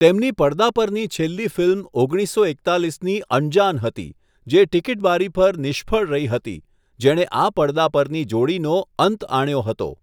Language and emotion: Gujarati, neutral